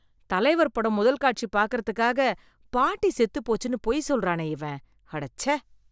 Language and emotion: Tamil, disgusted